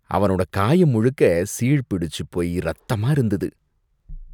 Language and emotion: Tamil, disgusted